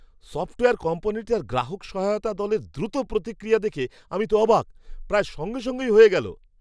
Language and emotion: Bengali, surprised